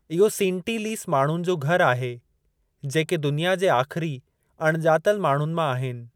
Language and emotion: Sindhi, neutral